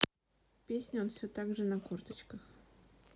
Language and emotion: Russian, neutral